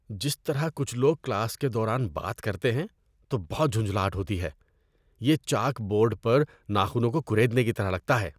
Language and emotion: Urdu, disgusted